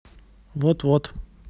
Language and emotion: Russian, neutral